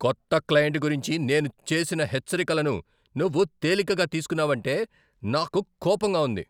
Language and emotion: Telugu, angry